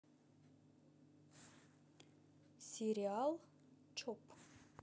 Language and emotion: Russian, neutral